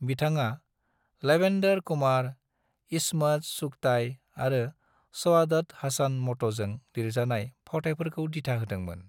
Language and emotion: Bodo, neutral